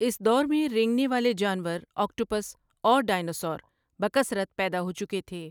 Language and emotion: Urdu, neutral